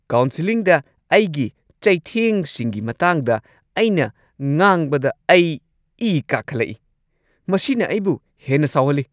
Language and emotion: Manipuri, angry